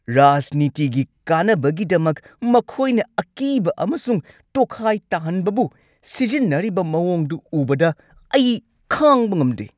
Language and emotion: Manipuri, angry